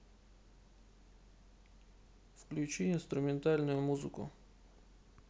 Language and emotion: Russian, neutral